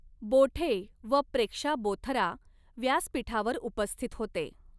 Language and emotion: Marathi, neutral